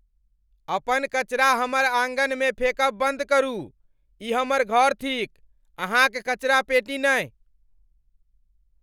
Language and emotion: Maithili, angry